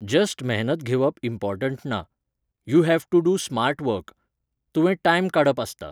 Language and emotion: Goan Konkani, neutral